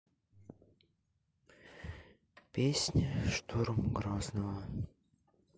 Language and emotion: Russian, sad